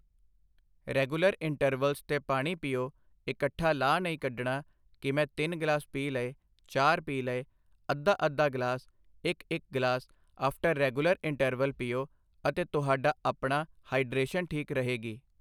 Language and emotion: Punjabi, neutral